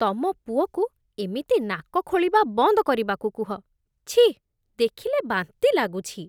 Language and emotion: Odia, disgusted